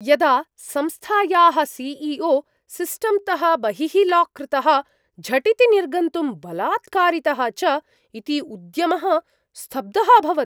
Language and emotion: Sanskrit, surprised